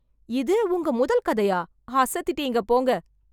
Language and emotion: Tamil, surprised